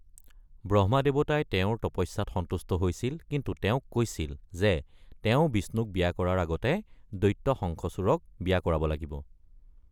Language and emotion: Assamese, neutral